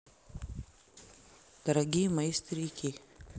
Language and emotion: Russian, neutral